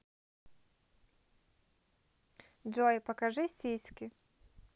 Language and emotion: Russian, neutral